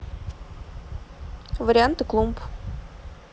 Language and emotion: Russian, neutral